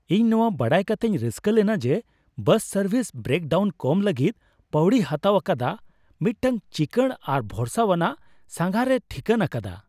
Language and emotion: Santali, happy